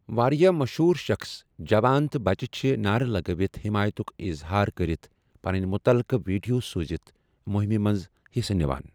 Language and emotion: Kashmiri, neutral